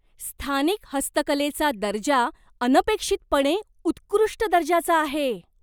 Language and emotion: Marathi, surprised